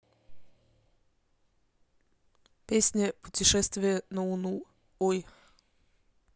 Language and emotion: Russian, neutral